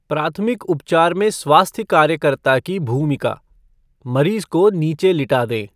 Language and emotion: Hindi, neutral